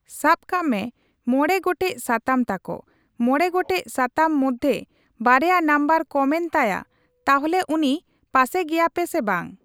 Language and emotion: Santali, neutral